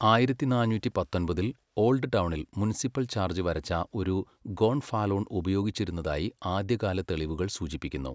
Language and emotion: Malayalam, neutral